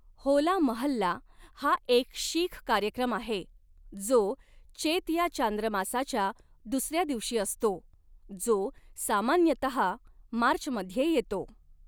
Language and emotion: Marathi, neutral